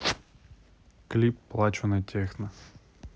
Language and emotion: Russian, neutral